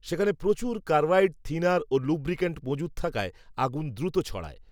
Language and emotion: Bengali, neutral